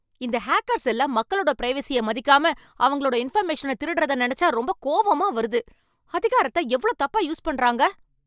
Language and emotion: Tamil, angry